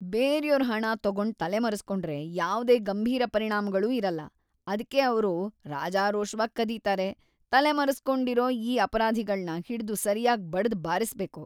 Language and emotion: Kannada, disgusted